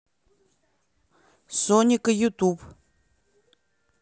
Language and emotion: Russian, neutral